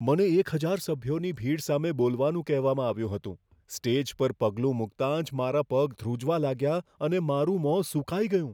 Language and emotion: Gujarati, fearful